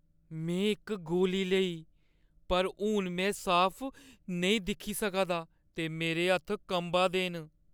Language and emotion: Dogri, fearful